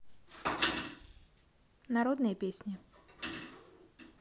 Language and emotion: Russian, neutral